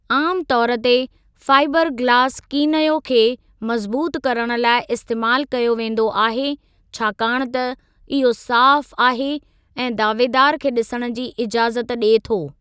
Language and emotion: Sindhi, neutral